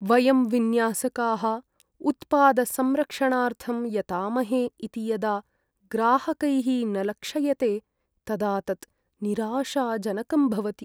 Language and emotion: Sanskrit, sad